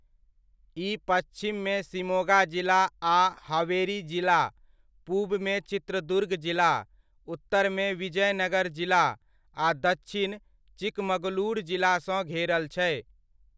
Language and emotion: Maithili, neutral